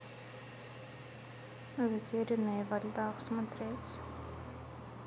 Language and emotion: Russian, neutral